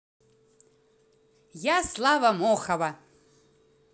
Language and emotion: Russian, positive